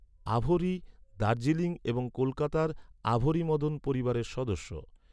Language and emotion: Bengali, neutral